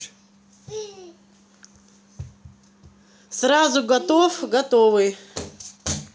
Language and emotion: Russian, neutral